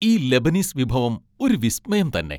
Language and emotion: Malayalam, happy